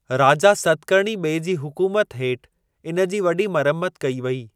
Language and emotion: Sindhi, neutral